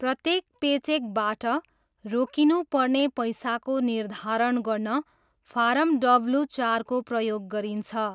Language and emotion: Nepali, neutral